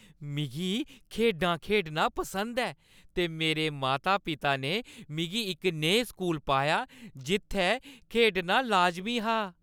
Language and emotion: Dogri, happy